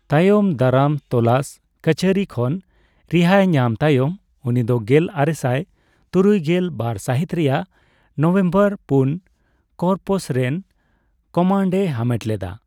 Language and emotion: Santali, neutral